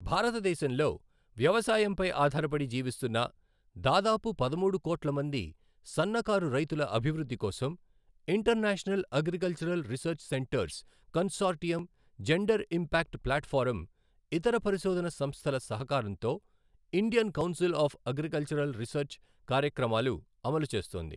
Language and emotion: Telugu, neutral